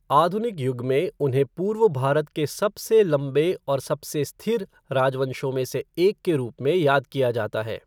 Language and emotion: Hindi, neutral